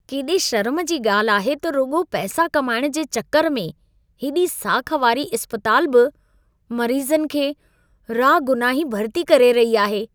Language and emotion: Sindhi, disgusted